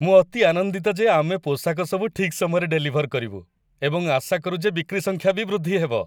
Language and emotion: Odia, happy